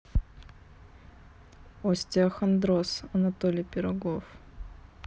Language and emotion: Russian, neutral